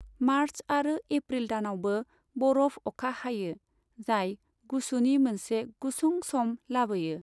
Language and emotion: Bodo, neutral